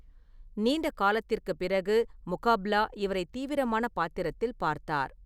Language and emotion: Tamil, neutral